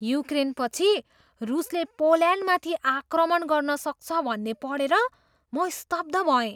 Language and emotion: Nepali, surprised